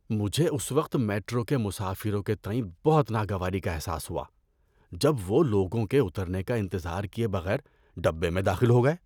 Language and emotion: Urdu, disgusted